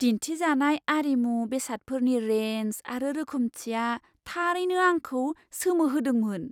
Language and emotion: Bodo, surprised